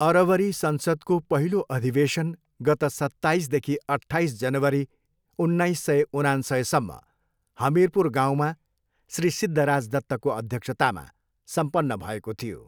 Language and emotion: Nepali, neutral